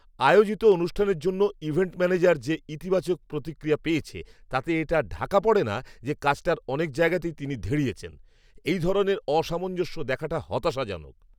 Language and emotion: Bengali, angry